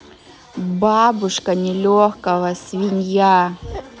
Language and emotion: Russian, neutral